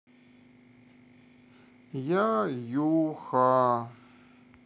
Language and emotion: Russian, sad